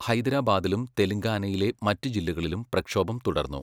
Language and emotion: Malayalam, neutral